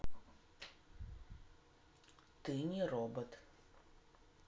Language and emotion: Russian, neutral